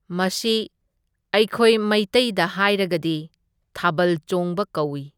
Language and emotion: Manipuri, neutral